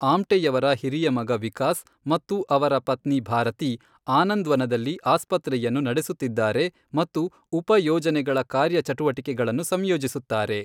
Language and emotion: Kannada, neutral